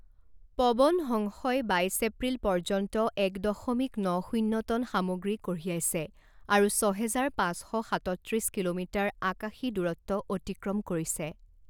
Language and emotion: Assamese, neutral